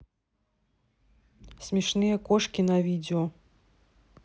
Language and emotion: Russian, neutral